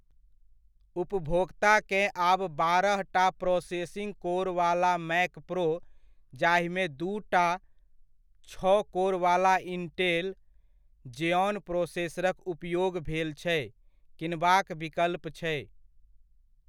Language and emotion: Maithili, neutral